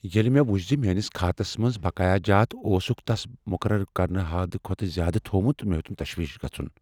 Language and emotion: Kashmiri, fearful